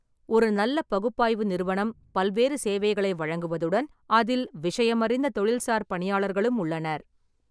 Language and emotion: Tamil, neutral